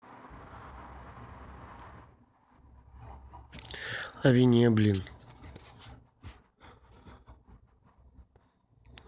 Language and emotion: Russian, neutral